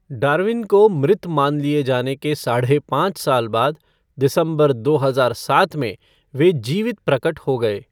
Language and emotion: Hindi, neutral